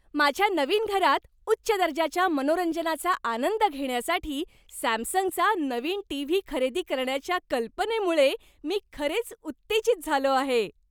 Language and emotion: Marathi, happy